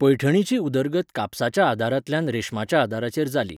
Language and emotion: Goan Konkani, neutral